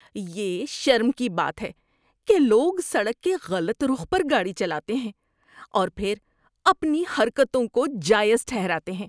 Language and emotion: Urdu, disgusted